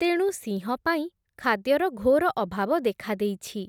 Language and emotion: Odia, neutral